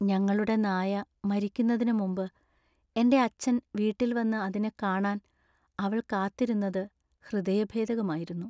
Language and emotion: Malayalam, sad